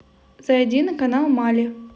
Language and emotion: Russian, positive